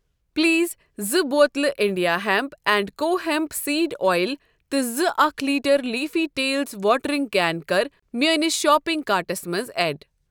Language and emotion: Kashmiri, neutral